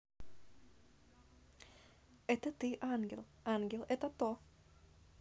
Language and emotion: Russian, positive